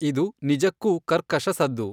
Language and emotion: Kannada, neutral